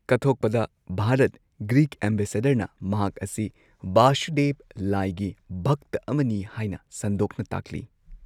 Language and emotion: Manipuri, neutral